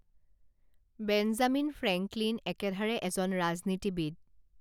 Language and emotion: Assamese, neutral